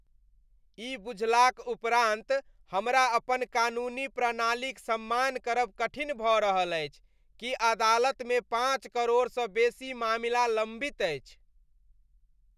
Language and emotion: Maithili, disgusted